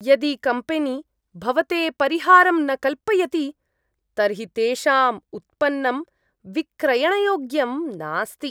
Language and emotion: Sanskrit, disgusted